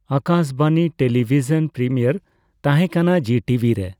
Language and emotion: Santali, neutral